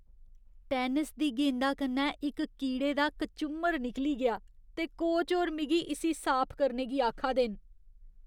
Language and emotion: Dogri, disgusted